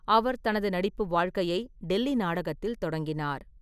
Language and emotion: Tamil, neutral